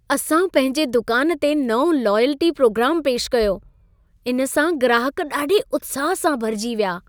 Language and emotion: Sindhi, happy